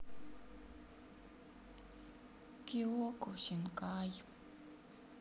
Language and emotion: Russian, sad